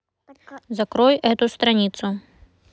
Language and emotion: Russian, neutral